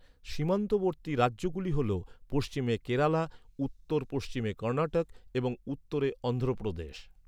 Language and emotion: Bengali, neutral